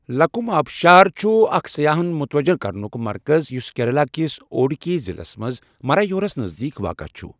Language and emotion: Kashmiri, neutral